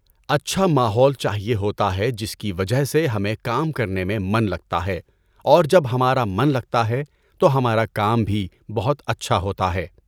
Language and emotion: Urdu, neutral